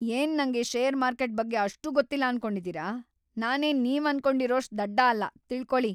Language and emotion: Kannada, angry